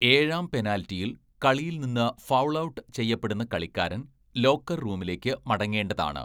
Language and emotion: Malayalam, neutral